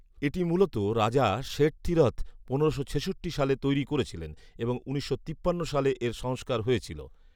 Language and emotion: Bengali, neutral